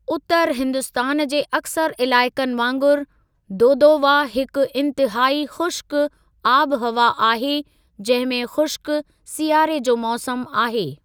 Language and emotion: Sindhi, neutral